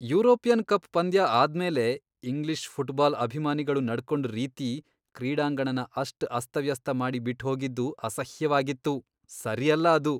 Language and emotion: Kannada, disgusted